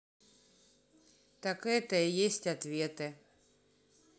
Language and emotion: Russian, neutral